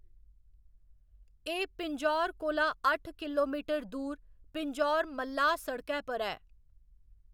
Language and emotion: Dogri, neutral